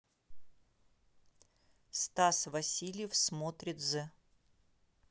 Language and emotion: Russian, neutral